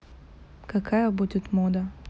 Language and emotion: Russian, neutral